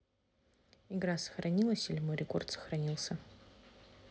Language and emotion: Russian, neutral